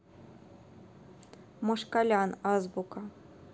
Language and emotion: Russian, neutral